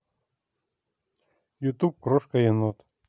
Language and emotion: Russian, neutral